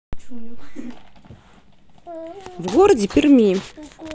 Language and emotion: Russian, neutral